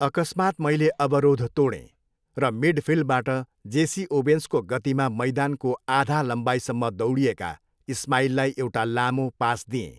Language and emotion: Nepali, neutral